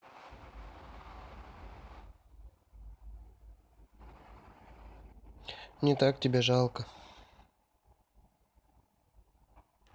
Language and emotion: Russian, sad